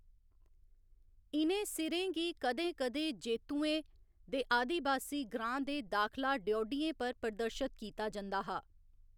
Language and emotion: Dogri, neutral